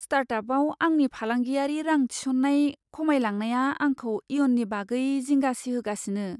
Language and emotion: Bodo, fearful